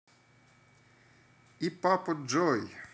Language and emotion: Russian, positive